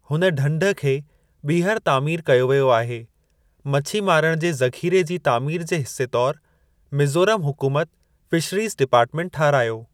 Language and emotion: Sindhi, neutral